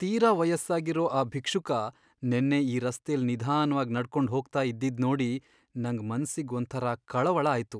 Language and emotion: Kannada, sad